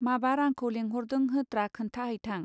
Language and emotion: Bodo, neutral